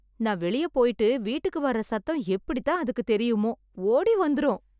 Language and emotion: Tamil, happy